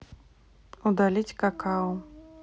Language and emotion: Russian, neutral